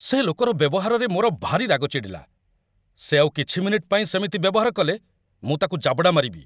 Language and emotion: Odia, angry